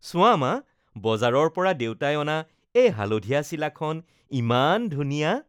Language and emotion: Assamese, happy